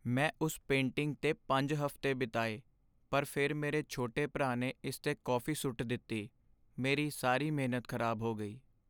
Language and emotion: Punjabi, sad